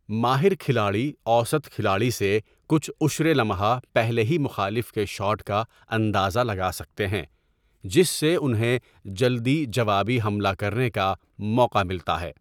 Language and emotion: Urdu, neutral